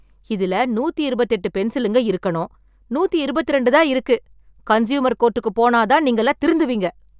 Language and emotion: Tamil, angry